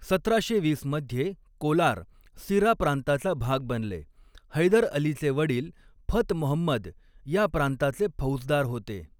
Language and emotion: Marathi, neutral